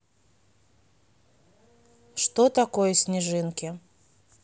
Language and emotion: Russian, neutral